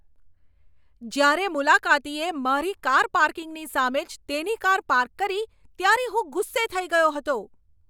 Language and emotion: Gujarati, angry